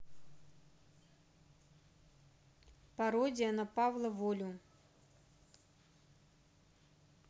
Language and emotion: Russian, neutral